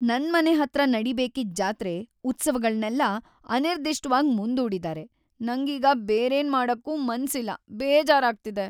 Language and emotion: Kannada, sad